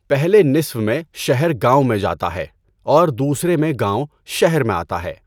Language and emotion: Urdu, neutral